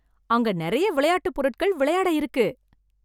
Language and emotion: Tamil, happy